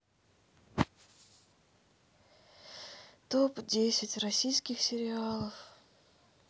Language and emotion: Russian, sad